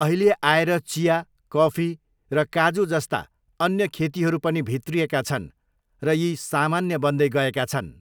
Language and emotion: Nepali, neutral